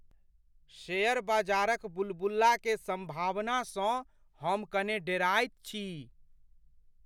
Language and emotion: Maithili, fearful